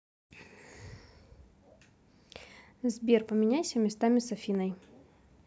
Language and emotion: Russian, neutral